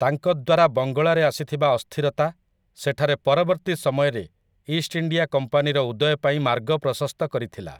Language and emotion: Odia, neutral